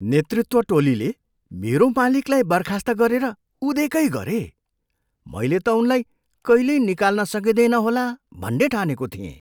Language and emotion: Nepali, surprised